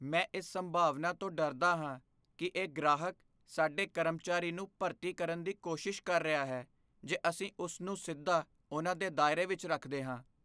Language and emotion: Punjabi, fearful